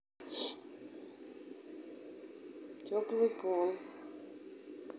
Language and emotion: Russian, neutral